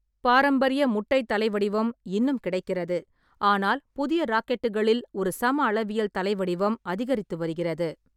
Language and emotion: Tamil, neutral